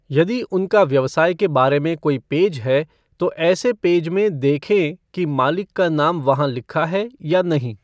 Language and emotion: Hindi, neutral